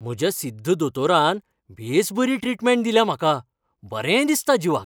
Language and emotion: Goan Konkani, happy